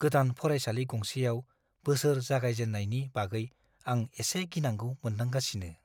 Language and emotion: Bodo, fearful